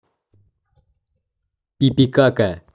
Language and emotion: Russian, neutral